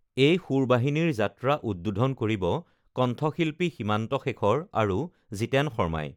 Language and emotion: Assamese, neutral